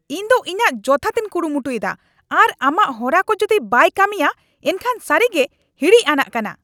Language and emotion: Santali, angry